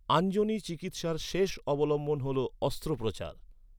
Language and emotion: Bengali, neutral